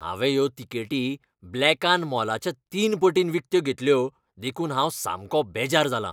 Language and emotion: Goan Konkani, angry